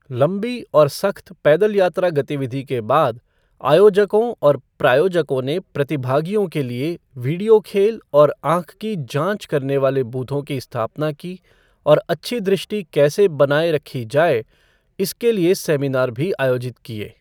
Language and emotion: Hindi, neutral